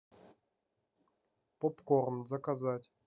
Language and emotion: Russian, neutral